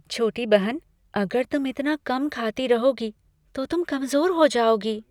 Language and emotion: Hindi, fearful